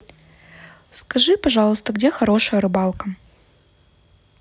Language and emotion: Russian, neutral